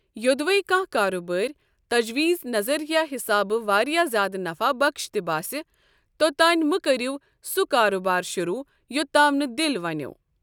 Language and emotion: Kashmiri, neutral